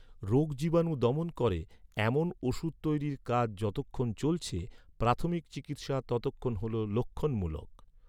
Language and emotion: Bengali, neutral